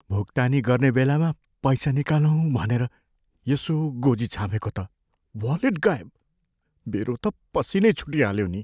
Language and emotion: Nepali, fearful